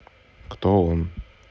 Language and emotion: Russian, neutral